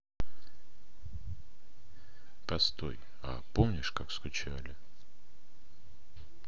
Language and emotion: Russian, neutral